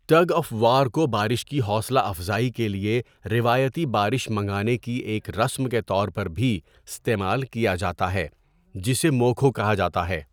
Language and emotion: Urdu, neutral